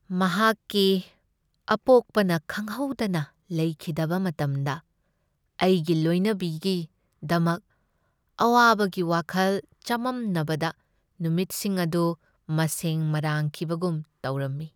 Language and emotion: Manipuri, sad